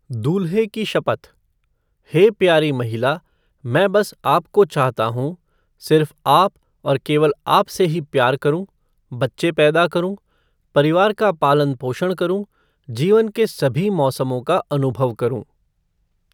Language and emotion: Hindi, neutral